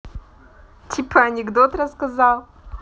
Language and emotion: Russian, positive